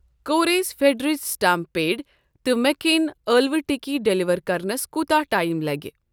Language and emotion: Kashmiri, neutral